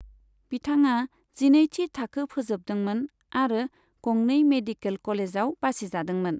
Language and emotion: Bodo, neutral